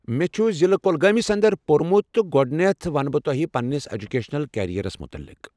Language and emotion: Kashmiri, neutral